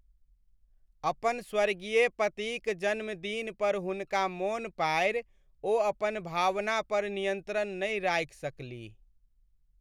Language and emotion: Maithili, sad